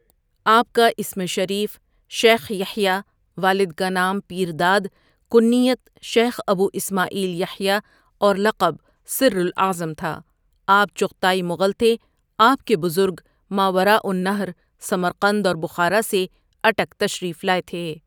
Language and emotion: Urdu, neutral